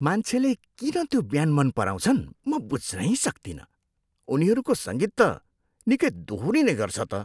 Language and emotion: Nepali, disgusted